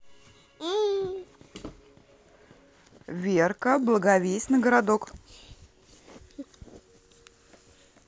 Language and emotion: Russian, positive